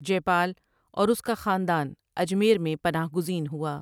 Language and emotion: Urdu, neutral